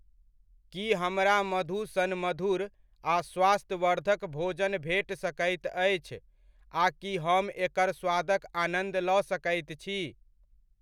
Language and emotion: Maithili, neutral